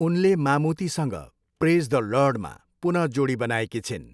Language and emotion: Nepali, neutral